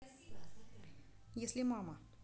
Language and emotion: Russian, neutral